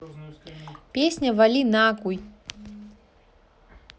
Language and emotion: Russian, neutral